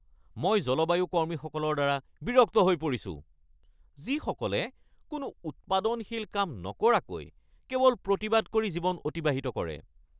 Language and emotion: Assamese, angry